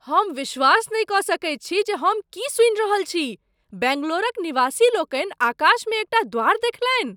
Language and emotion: Maithili, surprised